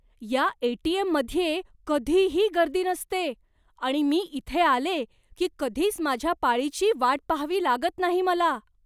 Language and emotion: Marathi, surprised